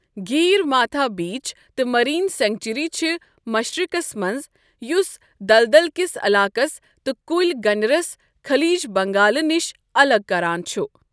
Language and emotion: Kashmiri, neutral